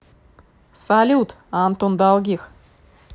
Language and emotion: Russian, positive